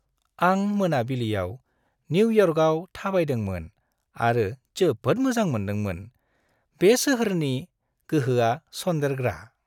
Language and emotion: Bodo, happy